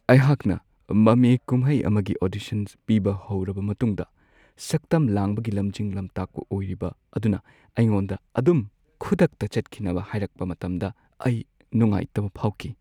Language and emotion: Manipuri, sad